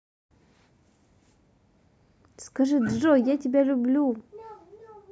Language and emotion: Russian, positive